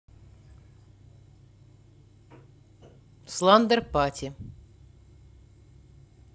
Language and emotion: Russian, neutral